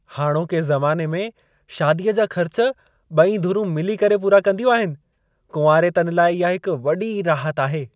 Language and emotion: Sindhi, happy